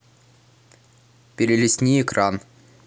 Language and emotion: Russian, neutral